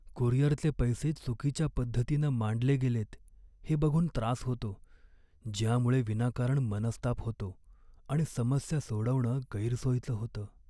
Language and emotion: Marathi, sad